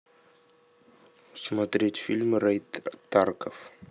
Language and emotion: Russian, neutral